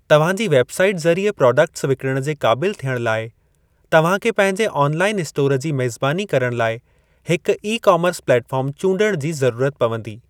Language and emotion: Sindhi, neutral